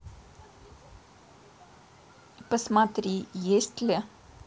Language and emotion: Russian, neutral